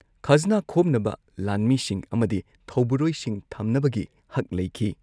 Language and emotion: Manipuri, neutral